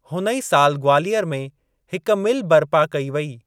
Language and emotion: Sindhi, neutral